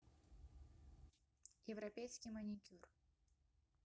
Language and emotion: Russian, neutral